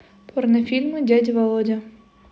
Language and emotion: Russian, neutral